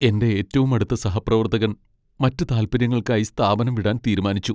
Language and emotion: Malayalam, sad